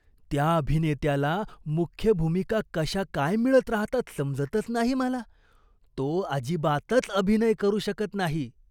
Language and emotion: Marathi, disgusted